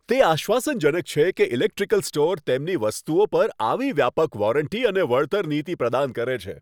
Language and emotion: Gujarati, happy